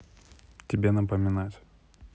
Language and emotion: Russian, neutral